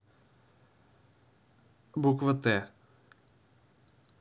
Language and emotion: Russian, neutral